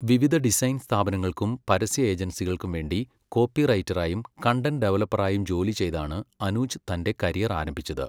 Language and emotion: Malayalam, neutral